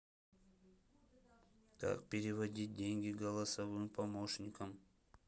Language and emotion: Russian, neutral